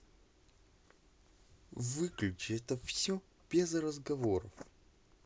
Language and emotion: Russian, angry